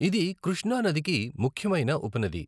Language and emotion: Telugu, neutral